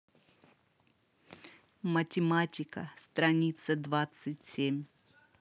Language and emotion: Russian, neutral